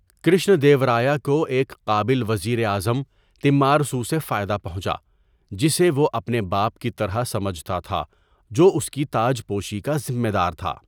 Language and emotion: Urdu, neutral